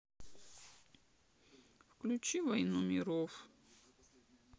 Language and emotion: Russian, sad